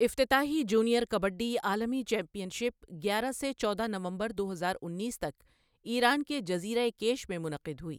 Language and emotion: Urdu, neutral